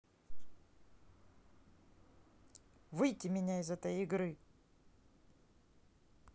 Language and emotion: Russian, angry